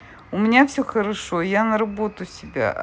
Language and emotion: Russian, neutral